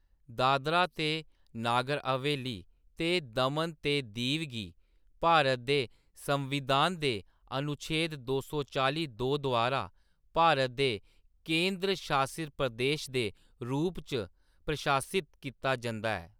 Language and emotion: Dogri, neutral